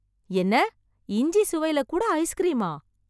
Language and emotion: Tamil, surprised